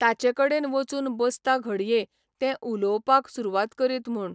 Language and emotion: Goan Konkani, neutral